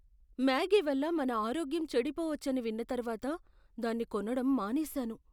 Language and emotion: Telugu, fearful